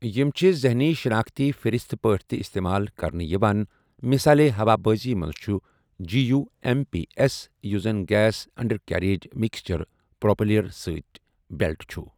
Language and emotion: Kashmiri, neutral